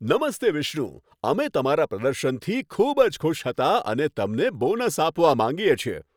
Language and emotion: Gujarati, happy